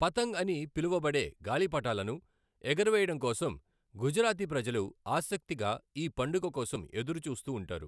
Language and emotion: Telugu, neutral